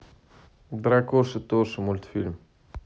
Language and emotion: Russian, neutral